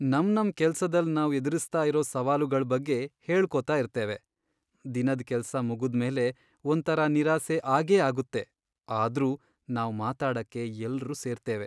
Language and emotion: Kannada, sad